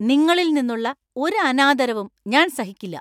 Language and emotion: Malayalam, angry